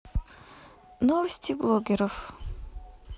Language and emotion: Russian, neutral